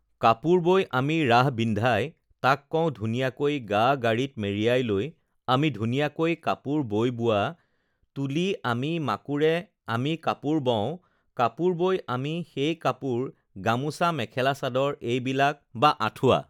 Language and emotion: Assamese, neutral